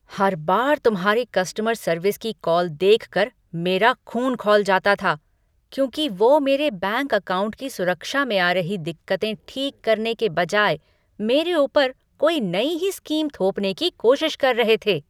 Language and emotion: Hindi, angry